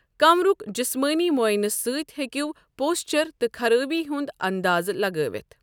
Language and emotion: Kashmiri, neutral